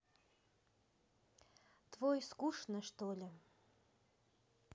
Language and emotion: Russian, neutral